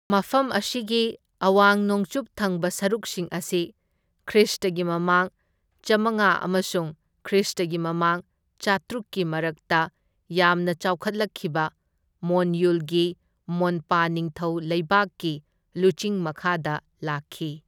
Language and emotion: Manipuri, neutral